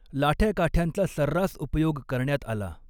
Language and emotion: Marathi, neutral